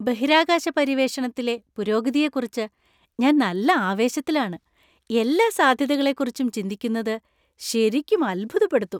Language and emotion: Malayalam, happy